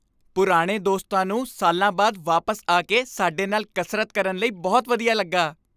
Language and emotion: Punjabi, happy